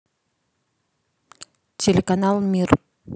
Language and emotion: Russian, neutral